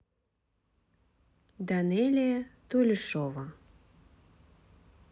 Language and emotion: Russian, neutral